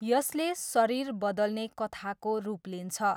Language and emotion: Nepali, neutral